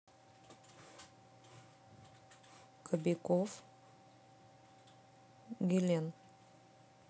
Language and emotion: Russian, neutral